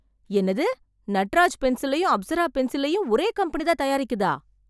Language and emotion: Tamil, surprised